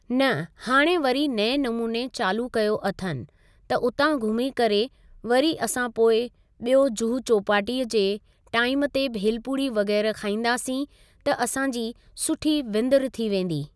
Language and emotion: Sindhi, neutral